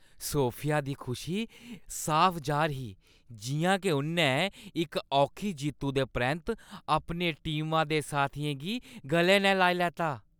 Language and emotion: Dogri, happy